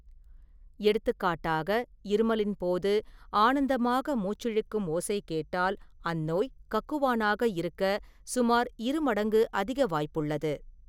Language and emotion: Tamil, neutral